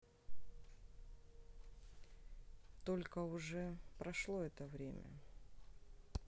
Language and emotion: Russian, sad